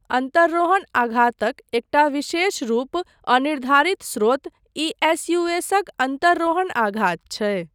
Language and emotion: Maithili, neutral